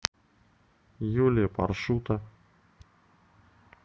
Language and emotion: Russian, neutral